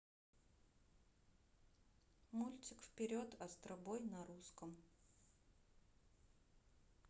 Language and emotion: Russian, neutral